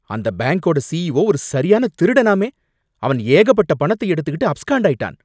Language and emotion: Tamil, angry